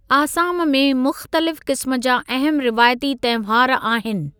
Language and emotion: Sindhi, neutral